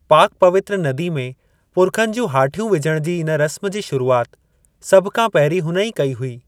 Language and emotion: Sindhi, neutral